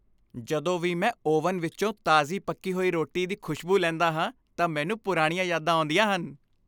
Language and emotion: Punjabi, happy